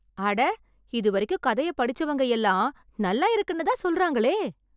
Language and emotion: Tamil, surprised